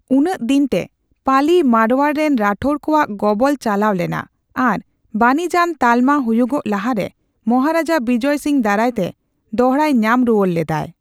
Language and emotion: Santali, neutral